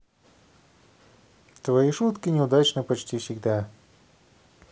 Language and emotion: Russian, neutral